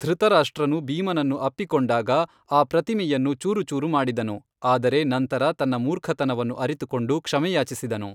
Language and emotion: Kannada, neutral